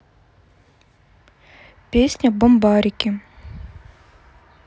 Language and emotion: Russian, neutral